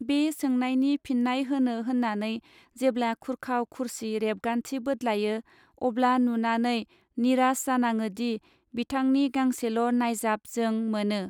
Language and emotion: Bodo, neutral